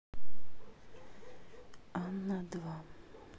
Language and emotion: Russian, neutral